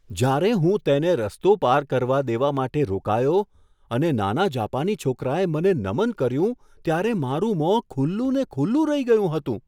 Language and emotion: Gujarati, surprised